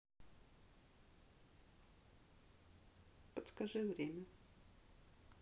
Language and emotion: Russian, sad